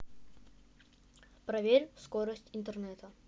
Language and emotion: Russian, neutral